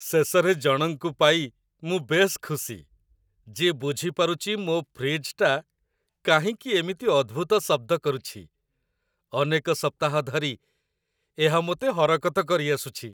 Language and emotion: Odia, happy